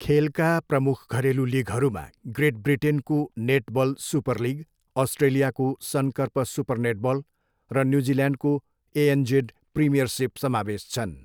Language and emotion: Nepali, neutral